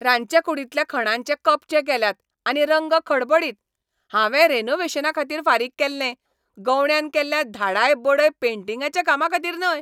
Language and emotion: Goan Konkani, angry